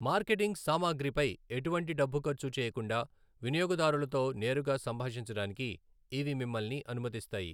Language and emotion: Telugu, neutral